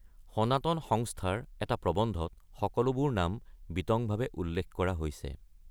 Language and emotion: Assamese, neutral